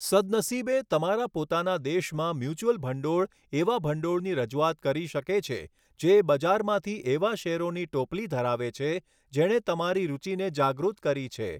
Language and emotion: Gujarati, neutral